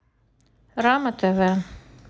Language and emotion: Russian, neutral